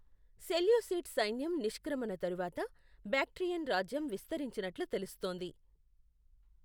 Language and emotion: Telugu, neutral